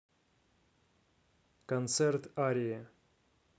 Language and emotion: Russian, neutral